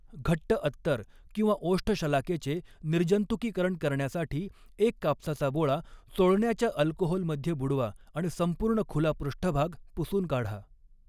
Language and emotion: Marathi, neutral